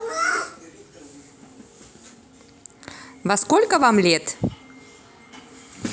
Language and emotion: Russian, neutral